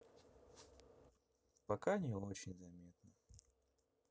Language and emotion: Russian, sad